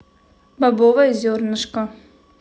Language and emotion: Russian, neutral